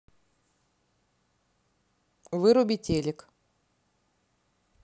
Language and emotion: Russian, neutral